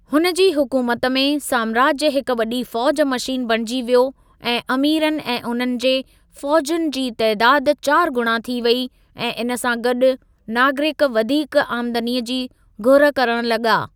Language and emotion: Sindhi, neutral